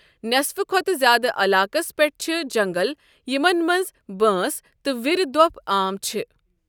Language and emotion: Kashmiri, neutral